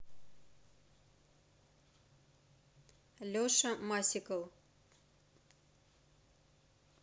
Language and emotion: Russian, neutral